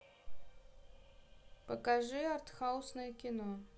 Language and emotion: Russian, neutral